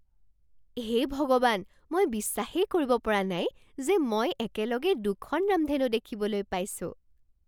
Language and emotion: Assamese, surprised